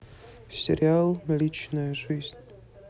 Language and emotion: Russian, sad